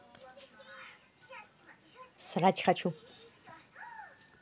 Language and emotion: Russian, neutral